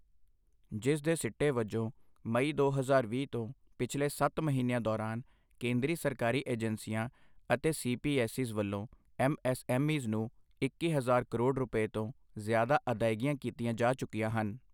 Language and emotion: Punjabi, neutral